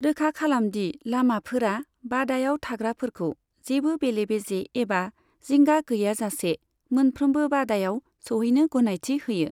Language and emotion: Bodo, neutral